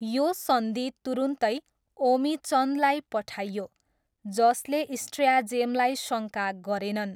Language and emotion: Nepali, neutral